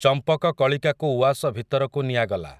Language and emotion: Odia, neutral